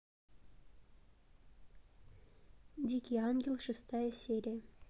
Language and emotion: Russian, neutral